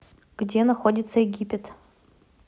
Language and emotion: Russian, neutral